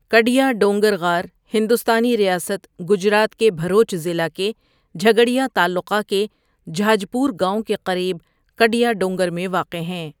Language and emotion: Urdu, neutral